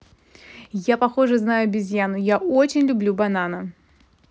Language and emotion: Russian, positive